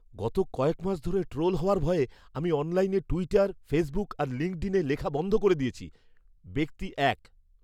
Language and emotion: Bengali, fearful